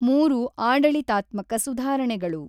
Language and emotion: Kannada, neutral